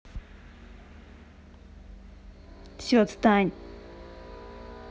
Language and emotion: Russian, angry